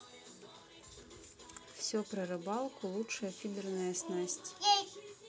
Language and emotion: Russian, neutral